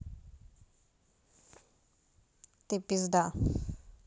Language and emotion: Russian, neutral